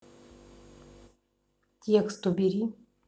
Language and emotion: Russian, neutral